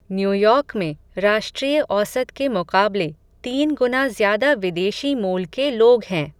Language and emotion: Hindi, neutral